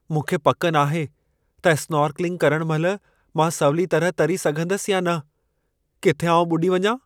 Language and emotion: Sindhi, fearful